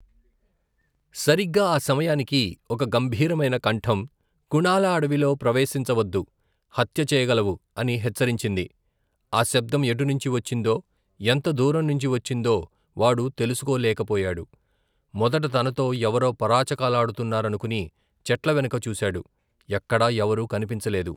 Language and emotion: Telugu, neutral